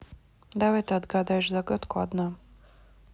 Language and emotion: Russian, neutral